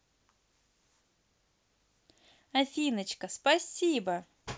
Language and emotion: Russian, positive